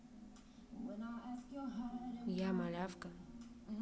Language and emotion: Russian, neutral